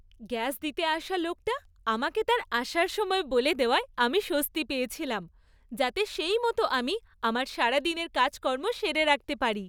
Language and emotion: Bengali, happy